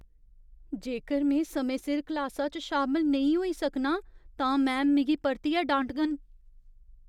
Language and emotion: Dogri, fearful